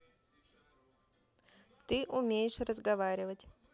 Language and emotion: Russian, neutral